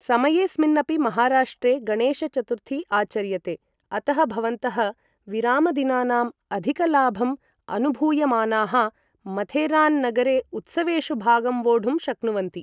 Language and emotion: Sanskrit, neutral